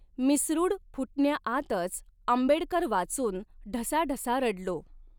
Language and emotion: Marathi, neutral